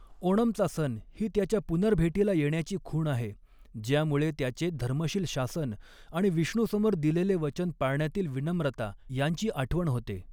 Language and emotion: Marathi, neutral